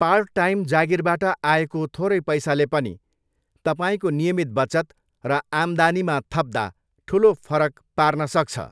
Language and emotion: Nepali, neutral